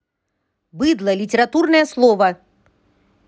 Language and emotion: Russian, angry